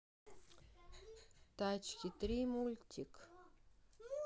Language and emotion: Russian, neutral